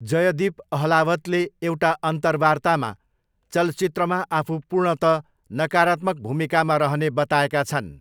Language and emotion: Nepali, neutral